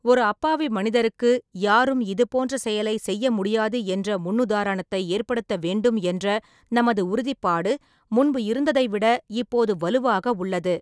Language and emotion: Tamil, neutral